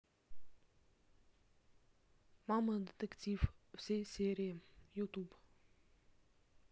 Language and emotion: Russian, neutral